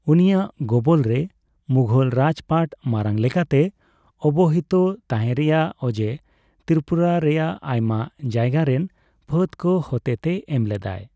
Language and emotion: Santali, neutral